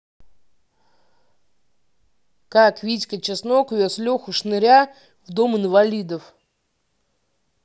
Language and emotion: Russian, neutral